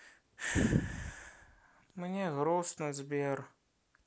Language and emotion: Russian, sad